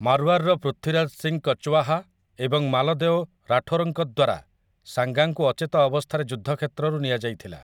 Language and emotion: Odia, neutral